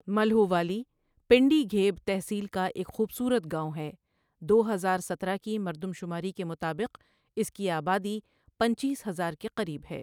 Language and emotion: Urdu, neutral